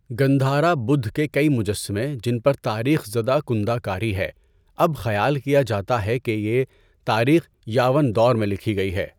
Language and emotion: Urdu, neutral